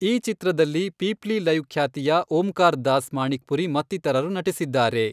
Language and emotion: Kannada, neutral